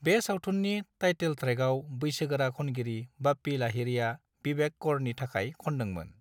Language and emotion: Bodo, neutral